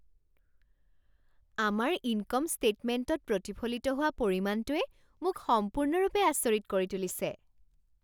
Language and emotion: Assamese, surprised